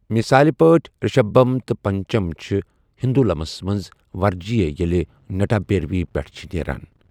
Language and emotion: Kashmiri, neutral